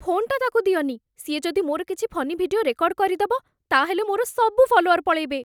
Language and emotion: Odia, fearful